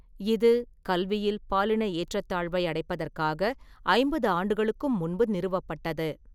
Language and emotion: Tamil, neutral